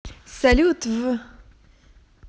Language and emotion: Russian, positive